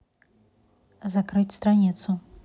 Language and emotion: Russian, neutral